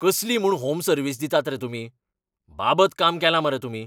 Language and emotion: Goan Konkani, angry